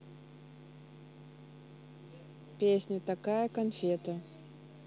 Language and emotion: Russian, neutral